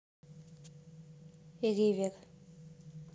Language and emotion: Russian, neutral